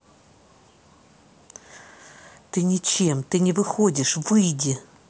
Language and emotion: Russian, angry